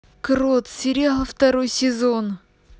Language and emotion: Russian, positive